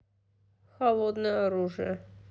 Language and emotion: Russian, neutral